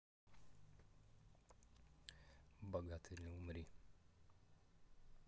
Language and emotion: Russian, neutral